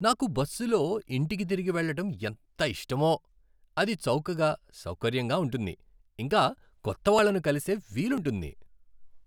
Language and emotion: Telugu, happy